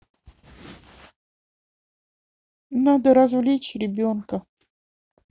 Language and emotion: Russian, sad